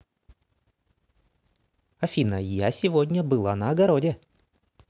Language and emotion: Russian, positive